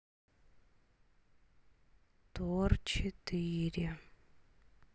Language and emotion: Russian, sad